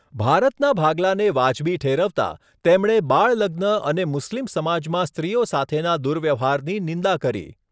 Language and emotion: Gujarati, neutral